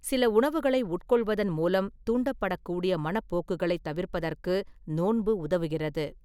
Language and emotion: Tamil, neutral